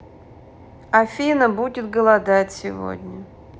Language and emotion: Russian, neutral